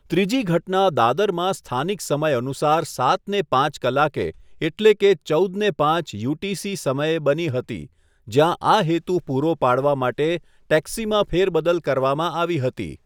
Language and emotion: Gujarati, neutral